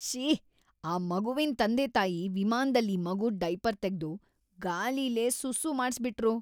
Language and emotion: Kannada, disgusted